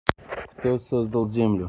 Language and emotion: Russian, neutral